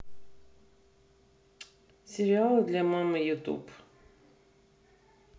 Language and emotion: Russian, neutral